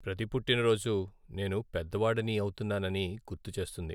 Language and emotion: Telugu, sad